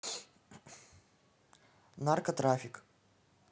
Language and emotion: Russian, neutral